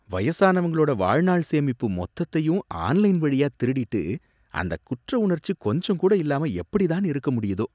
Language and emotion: Tamil, disgusted